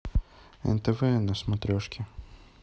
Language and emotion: Russian, neutral